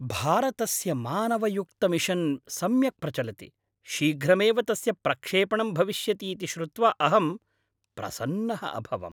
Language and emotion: Sanskrit, happy